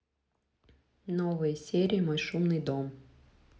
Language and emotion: Russian, neutral